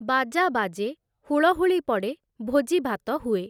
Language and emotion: Odia, neutral